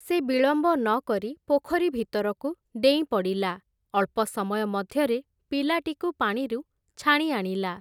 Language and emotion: Odia, neutral